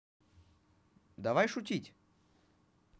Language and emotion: Russian, positive